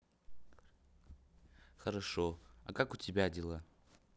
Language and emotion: Russian, neutral